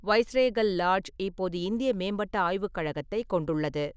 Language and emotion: Tamil, neutral